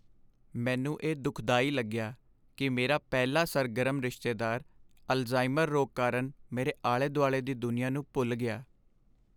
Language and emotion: Punjabi, sad